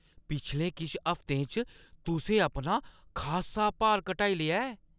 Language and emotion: Dogri, surprised